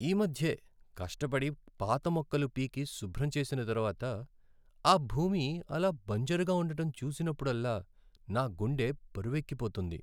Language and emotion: Telugu, sad